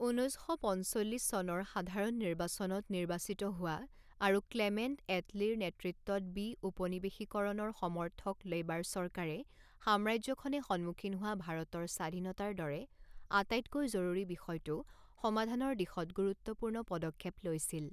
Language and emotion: Assamese, neutral